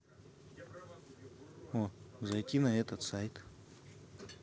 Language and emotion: Russian, neutral